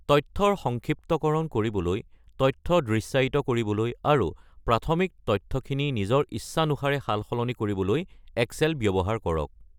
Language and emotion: Assamese, neutral